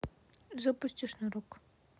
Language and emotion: Russian, neutral